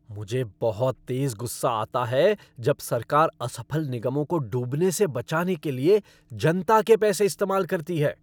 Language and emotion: Hindi, angry